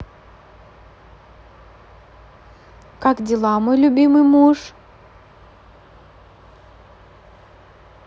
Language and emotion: Russian, positive